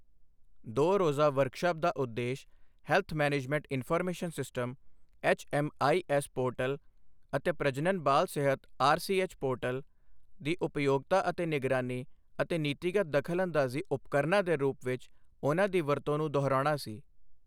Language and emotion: Punjabi, neutral